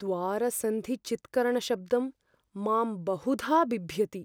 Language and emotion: Sanskrit, fearful